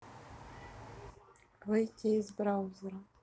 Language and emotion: Russian, neutral